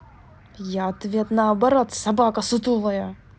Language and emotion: Russian, angry